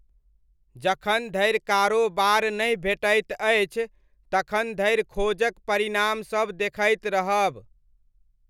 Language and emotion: Maithili, neutral